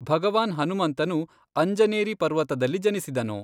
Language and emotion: Kannada, neutral